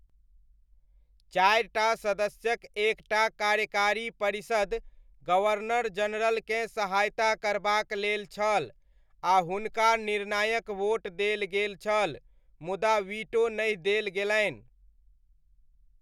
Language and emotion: Maithili, neutral